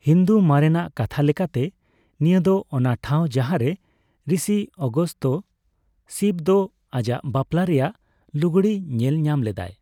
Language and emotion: Santali, neutral